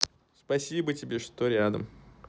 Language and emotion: Russian, neutral